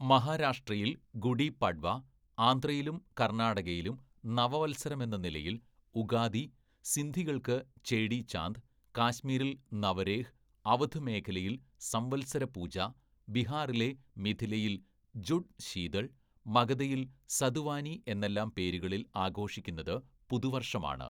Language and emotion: Malayalam, neutral